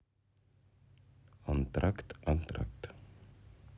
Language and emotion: Russian, neutral